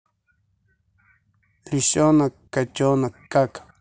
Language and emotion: Russian, neutral